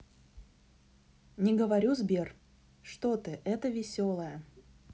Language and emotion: Russian, neutral